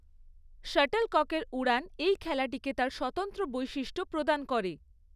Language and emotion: Bengali, neutral